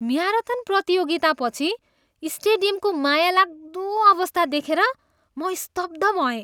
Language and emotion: Nepali, disgusted